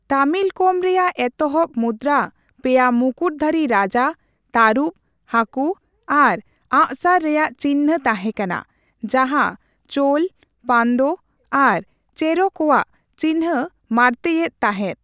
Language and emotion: Santali, neutral